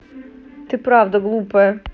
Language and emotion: Russian, neutral